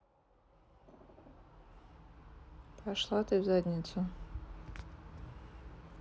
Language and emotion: Russian, neutral